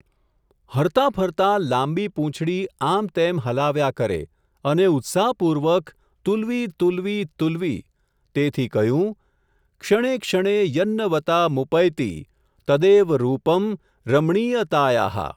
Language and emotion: Gujarati, neutral